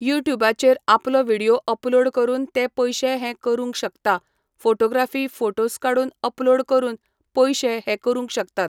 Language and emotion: Goan Konkani, neutral